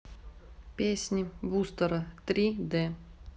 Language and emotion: Russian, neutral